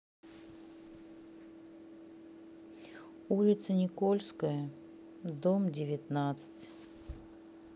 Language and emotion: Russian, sad